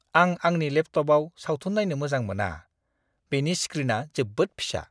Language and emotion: Bodo, disgusted